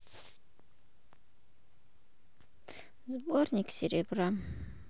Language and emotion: Russian, sad